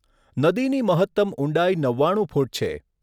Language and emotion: Gujarati, neutral